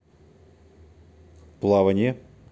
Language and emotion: Russian, neutral